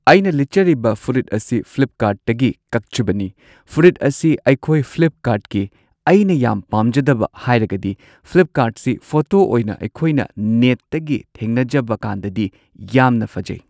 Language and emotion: Manipuri, neutral